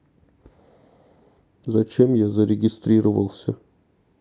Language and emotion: Russian, sad